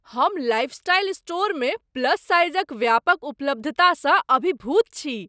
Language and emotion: Maithili, surprised